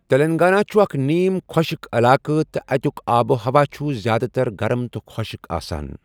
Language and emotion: Kashmiri, neutral